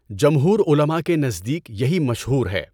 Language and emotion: Urdu, neutral